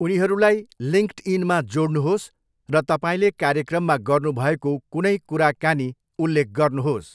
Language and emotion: Nepali, neutral